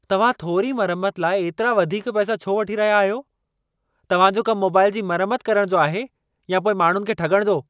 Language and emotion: Sindhi, angry